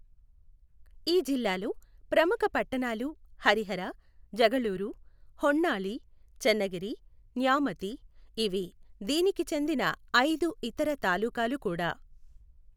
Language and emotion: Telugu, neutral